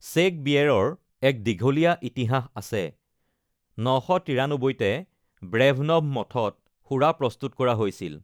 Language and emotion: Assamese, neutral